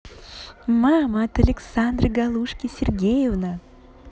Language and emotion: Russian, positive